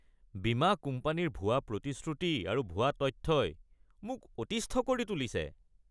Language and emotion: Assamese, disgusted